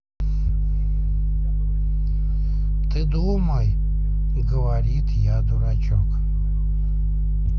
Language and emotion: Russian, neutral